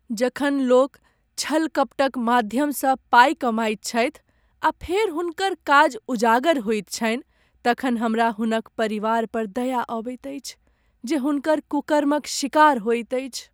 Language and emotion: Maithili, sad